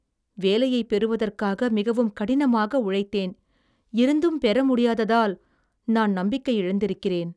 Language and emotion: Tamil, sad